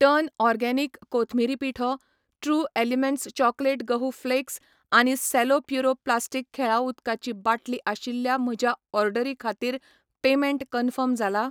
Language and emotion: Goan Konkani, neutral